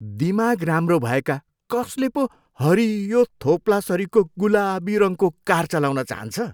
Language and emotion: Nepali, disgusted